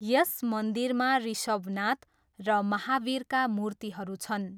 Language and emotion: Nepali, neutral